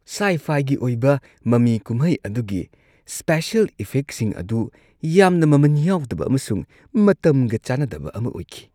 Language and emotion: Manipuri, disgusted